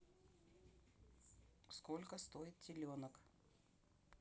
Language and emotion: Russian, neutral